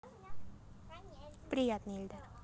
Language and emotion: Russian, positive